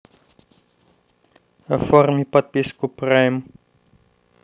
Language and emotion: Russian, neutral